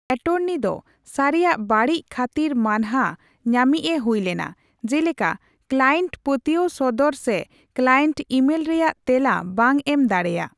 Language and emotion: Santali, neutral